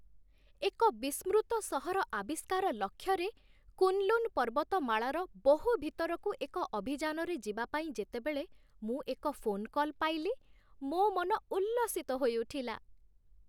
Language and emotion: Odia, happy